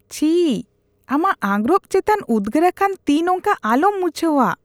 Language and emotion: Santali, disgusted